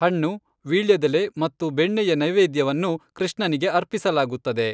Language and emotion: Kannada, neutral